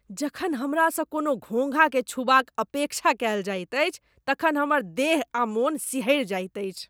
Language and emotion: Maithili, disgusted